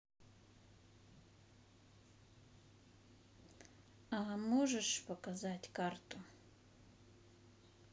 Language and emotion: Russian, neutral